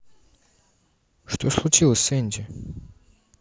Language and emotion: Russian, neutral